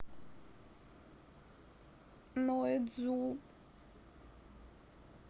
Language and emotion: Russian, sad